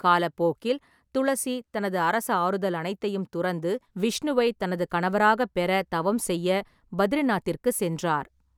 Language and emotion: Tamil, neutral